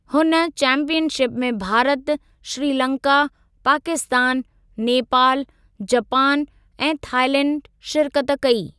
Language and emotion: Sindhi, neutral